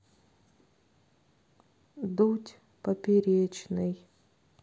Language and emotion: Russian, sad